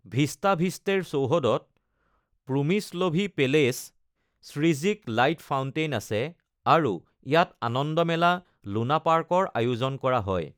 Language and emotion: Assamese, neutral